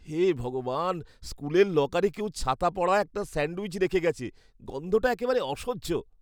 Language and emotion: Bengali, disgusted